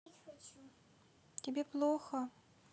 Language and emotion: Russian, sad